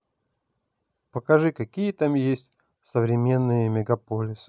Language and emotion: Russian, neutral